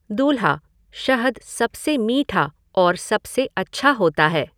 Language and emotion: Hindi, neutral